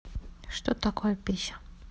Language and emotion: Russian, neutral